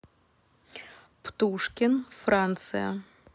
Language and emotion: Russian, neutral